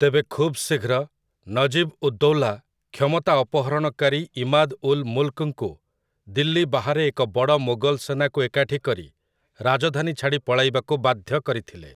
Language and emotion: Odia, neutral